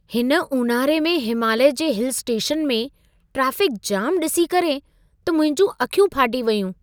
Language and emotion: Sindhi, surprised